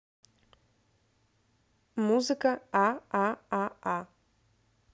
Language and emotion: Russian, neutral